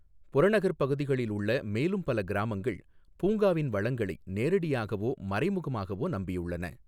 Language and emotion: Tamil, neutral